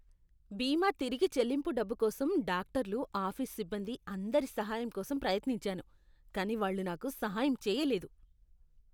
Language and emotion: Telugu, disgusted